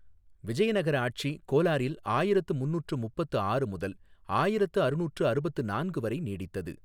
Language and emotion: Tamil, neutral